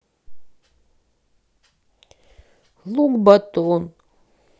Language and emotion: Russian, neutral